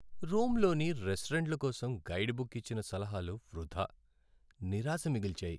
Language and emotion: Telugu, sad